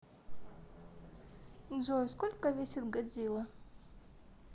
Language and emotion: Russian, neutral